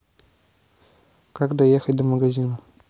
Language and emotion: Russian, neutral